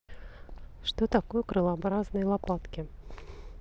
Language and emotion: Russian, neutral